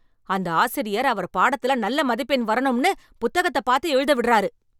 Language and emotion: Tamil, angry